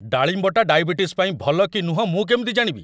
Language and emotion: Odia, angry